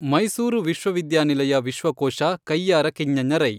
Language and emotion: Kannada, neutral